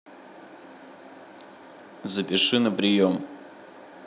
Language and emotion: Russian, neutral